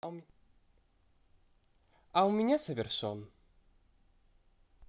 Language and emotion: Russian, positive